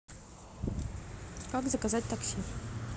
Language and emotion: Russian, neutral